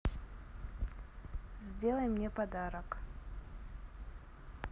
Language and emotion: Russian, neutral